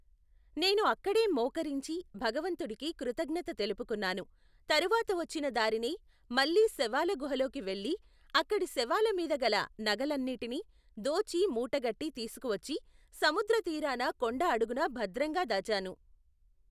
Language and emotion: Telugu, neutral